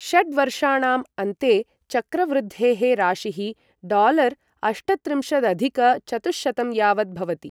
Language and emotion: Sanskrit, neutral